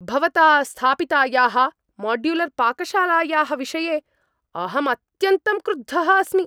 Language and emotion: Sanskrit, angry